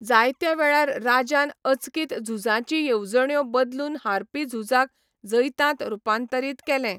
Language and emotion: Goan Konkani, neutral